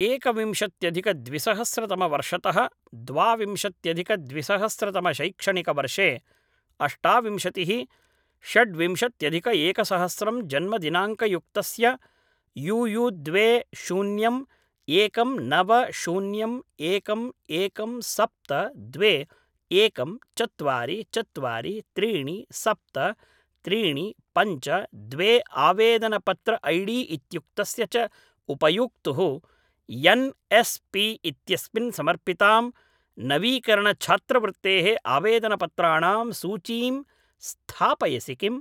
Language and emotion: Sanskrit, neutral